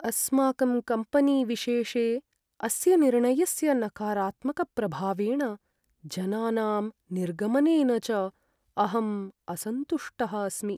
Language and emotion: Sanskrit, sad